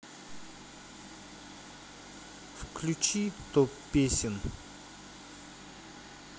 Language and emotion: Russian, neutral